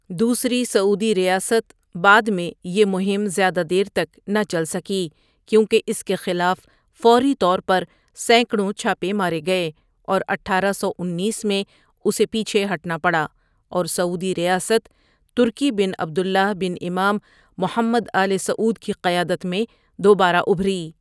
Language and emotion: Urdu, neutral